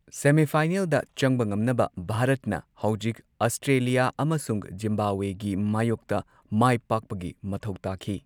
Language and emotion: Manipuri, neutral